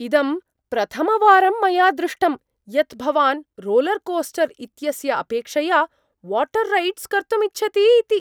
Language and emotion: Sanskrit, surprised